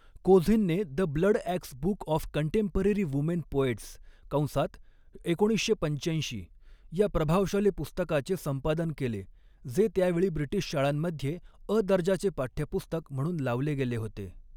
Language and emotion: Marathi, neutral